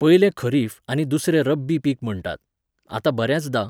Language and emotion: Goan Konkani, neutral